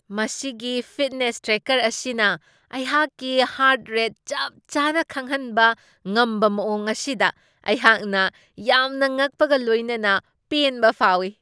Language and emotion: Manipuri, surprised